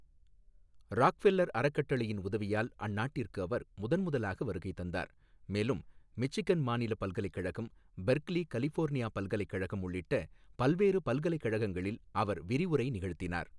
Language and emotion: Tamil, neutral